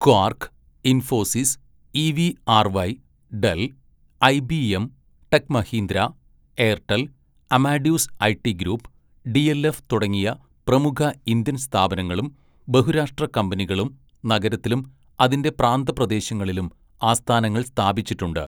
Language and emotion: Malayalam, neutral